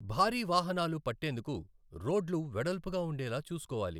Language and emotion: Telugu, neutral